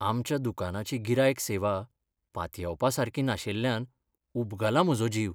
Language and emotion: Goan Konkani, sad